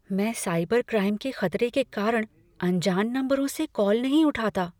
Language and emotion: Hindi, fearful